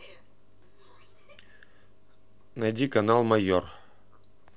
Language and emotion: Russian, neutral